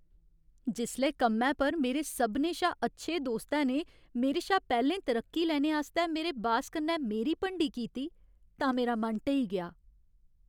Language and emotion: Dogri, sad